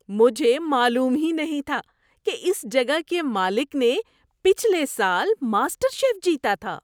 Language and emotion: Urdu, surprised